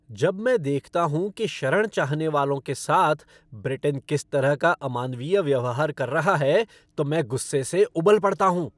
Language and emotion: Hindi, angry